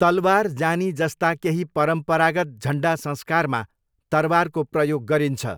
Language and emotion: Nepali, neutral